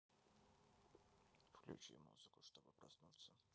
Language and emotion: Russian, neutral